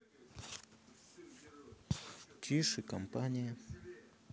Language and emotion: Russian, neutral